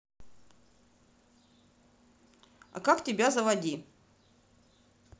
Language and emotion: Russian, neutral